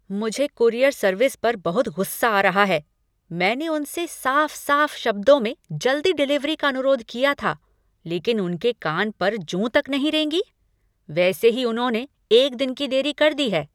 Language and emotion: Hindi, angry